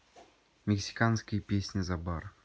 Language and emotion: Russian, neutral